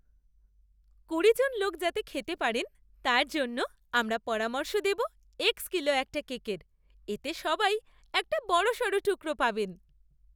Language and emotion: Bengali, happy